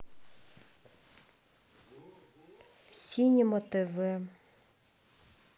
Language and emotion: Russian, sad